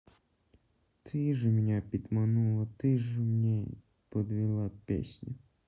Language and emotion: Russian, sad